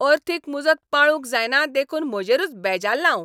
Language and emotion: Goan Konkani, angry